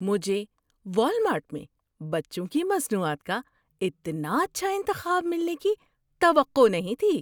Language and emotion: Urdu, surprised